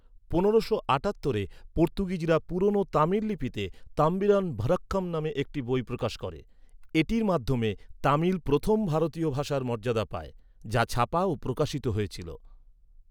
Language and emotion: Bengali, neutral